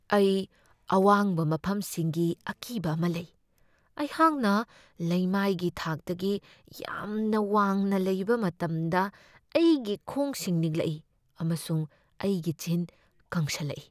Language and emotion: Manipuri, fearful